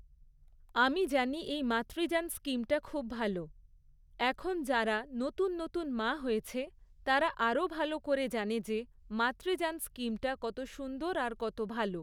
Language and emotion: Bengali, neutral